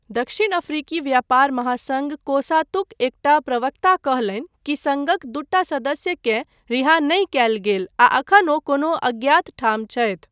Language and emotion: Maithili, neutral